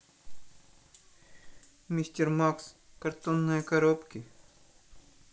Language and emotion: Russian, sad